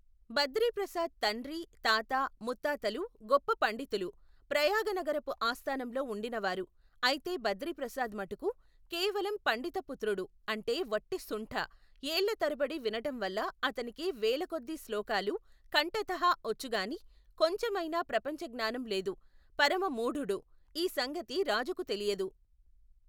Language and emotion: Telugu, neutral